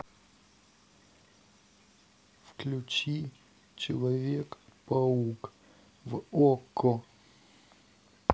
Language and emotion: Russian, sad